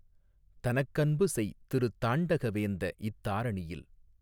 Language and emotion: Tamil, neutral